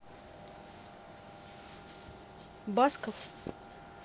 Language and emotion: Russian, neutral